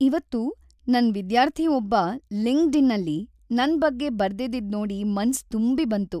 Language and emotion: Kannada, happy